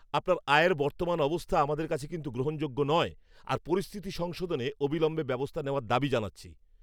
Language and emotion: Bengali, angry